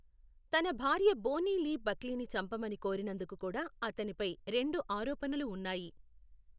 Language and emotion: Telugu, neutral